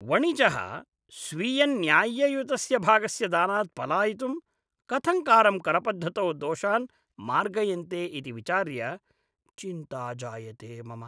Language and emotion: Sanskrit, disgusted